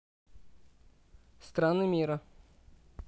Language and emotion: Russian, neutral